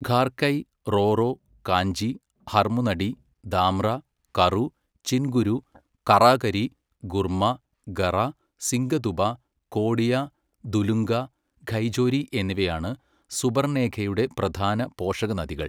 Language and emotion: Malayalam, neutral